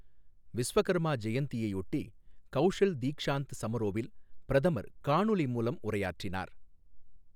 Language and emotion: Tamil, neutral